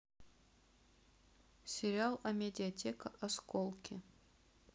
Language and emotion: Russian, neutral